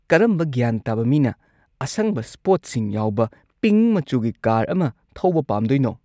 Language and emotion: Manipuri, disgusted